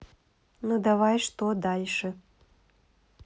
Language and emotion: Russian, neutral